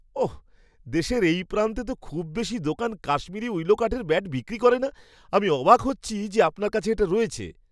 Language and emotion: Bengali, surprised